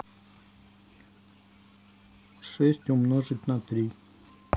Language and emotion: Russian, neutral